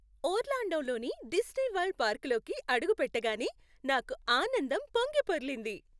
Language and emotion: Telugu, happy